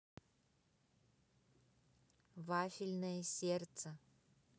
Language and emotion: Russian, neutral